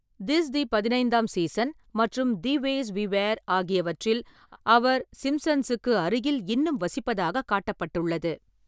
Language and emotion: Tamil, neutral